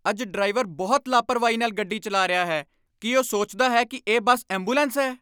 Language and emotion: Punjabi, angry